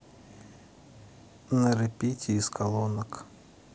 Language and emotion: Russian, neutral